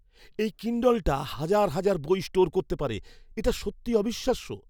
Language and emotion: Bengali, surprised